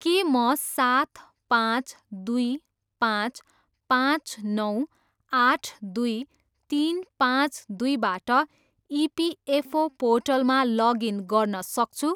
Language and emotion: Nepali, neutral